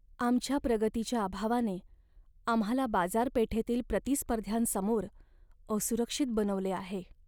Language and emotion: Marathi, sad